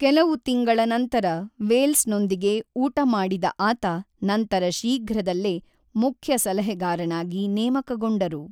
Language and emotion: Kannada, neutral